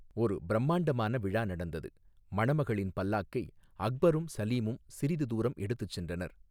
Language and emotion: Tamil, neutral